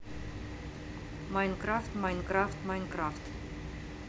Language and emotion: Russian, neutral